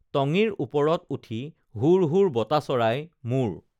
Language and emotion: Assamese, neutral